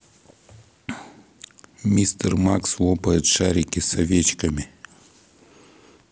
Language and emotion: Russian, neutral